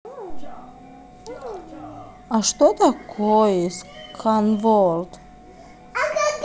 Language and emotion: Russian, neutral